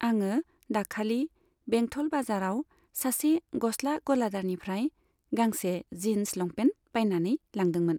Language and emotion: Bodo, neutral